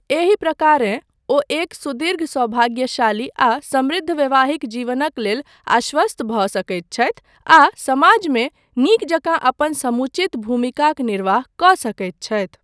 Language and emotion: Maithili, neutral